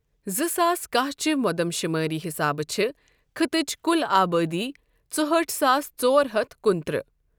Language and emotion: Kashmiri, neutral